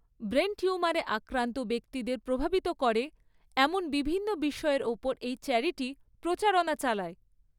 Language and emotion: Bengali, neutral